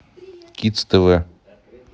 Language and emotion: Russian, neutral